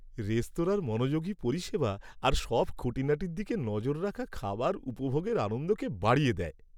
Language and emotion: Bengali, happy